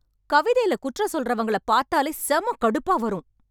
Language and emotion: Tamil, angry